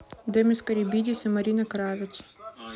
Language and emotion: Russian, neutral